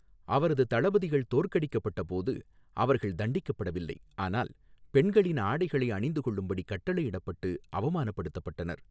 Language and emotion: Tamil, neutral